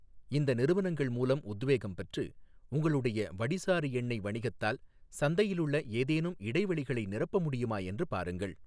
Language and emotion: Tamil, neutral